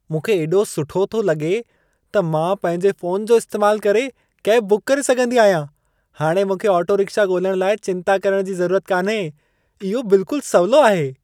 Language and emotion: Sindhi, happy